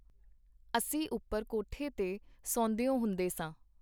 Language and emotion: Punjabi, neutral